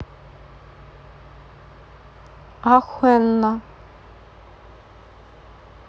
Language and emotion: Russian, neutral